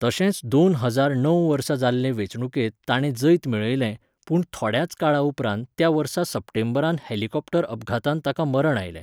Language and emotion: Goan Konkani, neutral